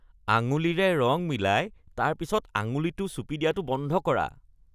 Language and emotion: Assamese, disgusted